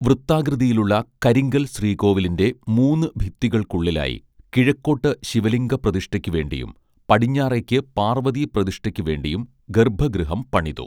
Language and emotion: Malayalam, neutral